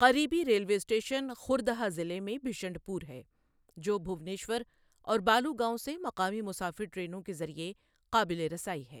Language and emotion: Urdu, neutral